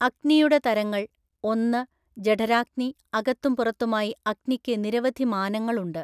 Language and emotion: Malayalam, neutral